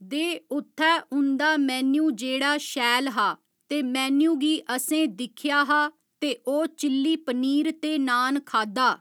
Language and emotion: Dogri, neutral